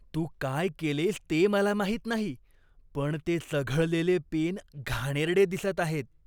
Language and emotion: Marathi, disgusted